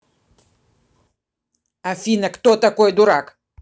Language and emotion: Russian, angry